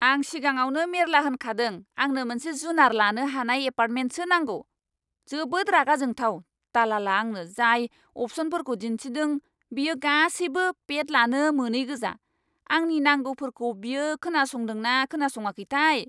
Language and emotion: Bodo, angry